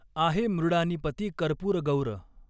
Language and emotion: Marathi, neutral